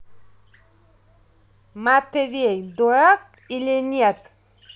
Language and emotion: Russian, neutral